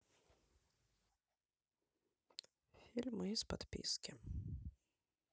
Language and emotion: Russian, neutral